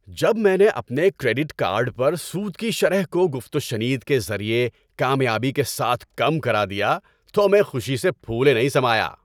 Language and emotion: Urdu, happy